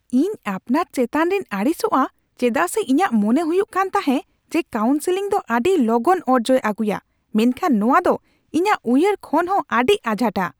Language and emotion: Santali, angry